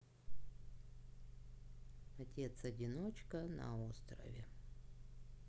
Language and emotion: Russian, sad